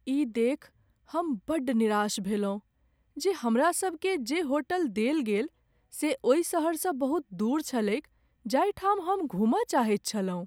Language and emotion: Maithili, sad